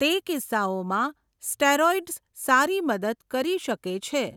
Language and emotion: Gujarati, neutral